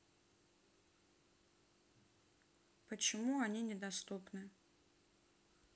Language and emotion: Russian, neutral